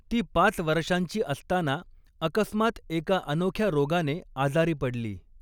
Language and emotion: Marathi, neutral